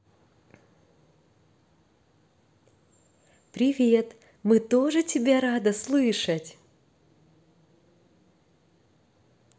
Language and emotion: Russian, positive